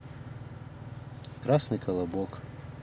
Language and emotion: Russian, neutral